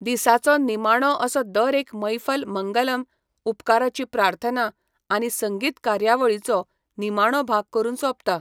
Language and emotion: Goan Konkani, neutral